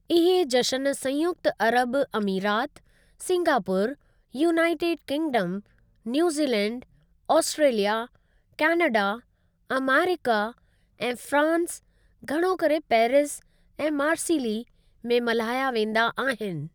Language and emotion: Sindhi, neutral